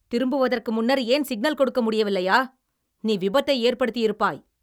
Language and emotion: Tamil, angry